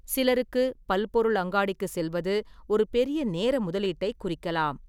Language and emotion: Tamil, neutral